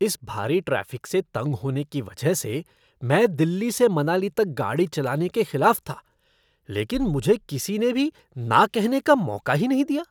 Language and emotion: Hindi, disgusted